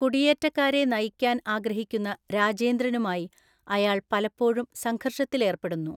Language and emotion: Malayalam, neutral